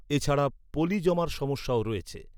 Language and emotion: Bengali, neutral